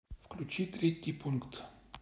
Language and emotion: Russian, neutral